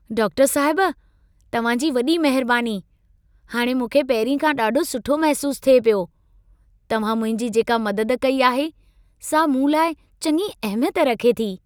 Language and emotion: Sindhi, happy